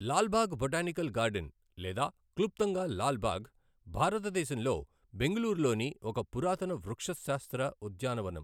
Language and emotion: Telugu, neutral